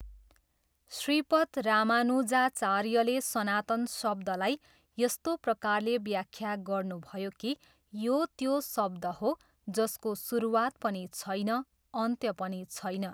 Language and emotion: Nepali, neutral